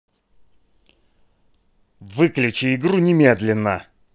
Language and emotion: Russian, angry